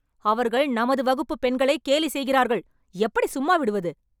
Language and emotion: Tamil, angry